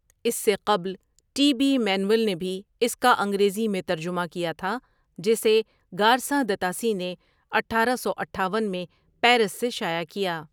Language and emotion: Urdu, neutral